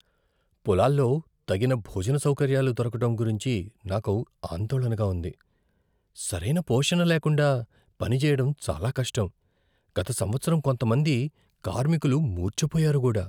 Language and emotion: Telugu, fearful